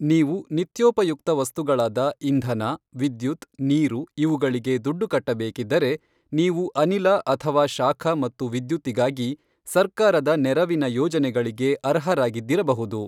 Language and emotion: Kannada, neutral